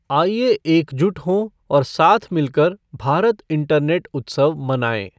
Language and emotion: Hindi, neutral